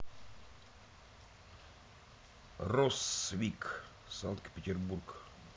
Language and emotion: Russian, neutral